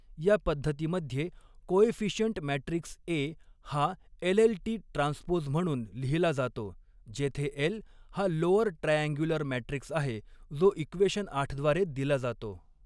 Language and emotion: Marathi, neutral